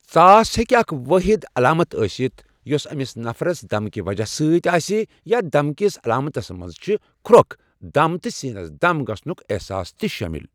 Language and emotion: Kashmiri, neutral